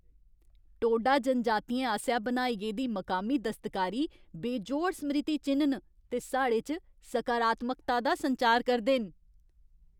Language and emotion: Dogri, happy